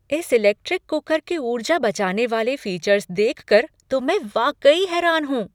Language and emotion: Hindi, surprised